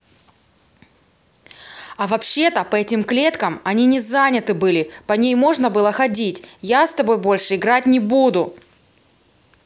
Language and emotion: Russian, angry